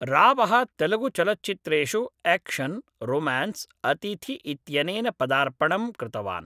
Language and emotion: Sanskrit, neutral